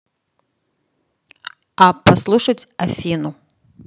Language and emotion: Russian, neutral